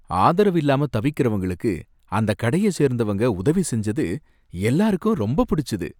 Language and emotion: Tamil, happy